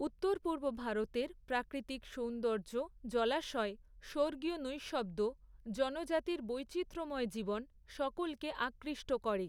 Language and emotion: Bengali, neutral